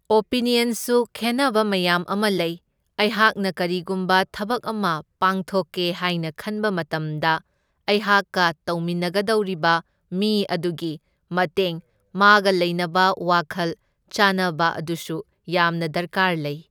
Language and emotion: Manipuri, neutral